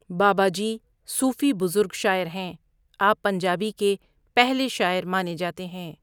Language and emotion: Urdu, neutral